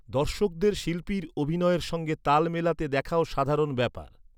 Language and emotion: Bengali, neutral